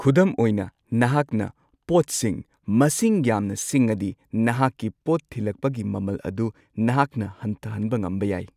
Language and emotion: Manipuri, neutral